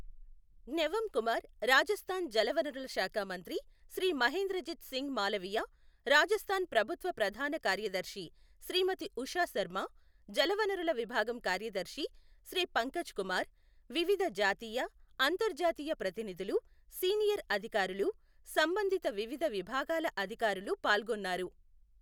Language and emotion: Telugu, neutral